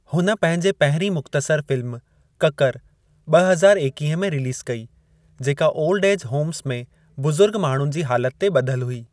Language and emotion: Sindhi, neutral